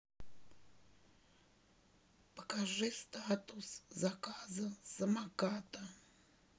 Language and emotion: Russian, neutral